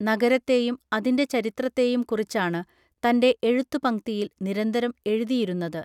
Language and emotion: Malayalam, neutral